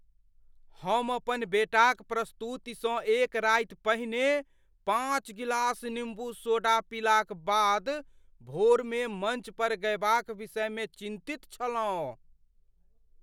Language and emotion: Maithili, fearful